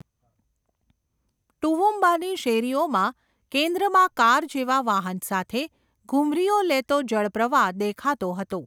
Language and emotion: Gujarati, neutral